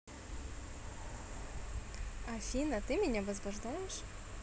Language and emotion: Russian, positive